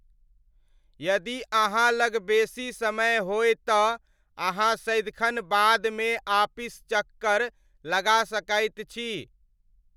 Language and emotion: Maithili, neutral